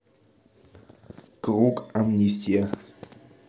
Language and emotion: Russian, neutral